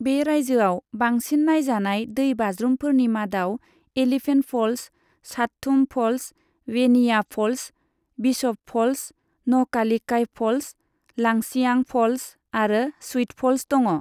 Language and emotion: Bodo, neutral